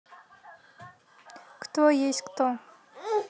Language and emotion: Russian, neutral